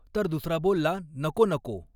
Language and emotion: Marathi, neutral